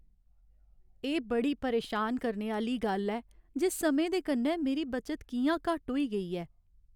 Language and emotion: Dogri, sad